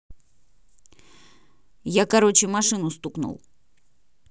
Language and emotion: Russian, neutral